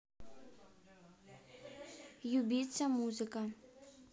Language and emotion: Russian, neutral